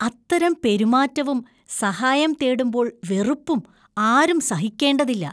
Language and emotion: Malayalam, disgusted